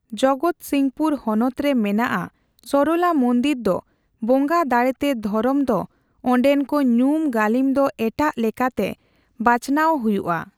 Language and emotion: Santali, neutral